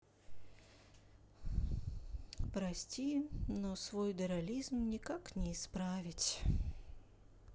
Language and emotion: Russian, sad